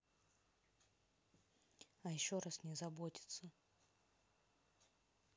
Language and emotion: Russian, neutral